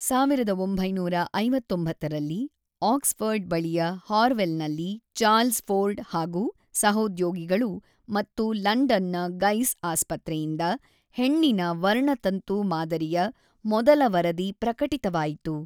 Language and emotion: Kannada, neutral